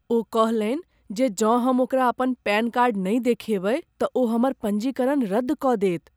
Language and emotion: Maithili, fearful